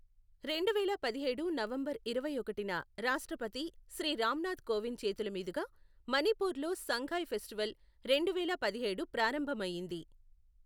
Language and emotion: Telugu, neutral